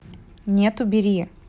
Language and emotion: Russian, neutral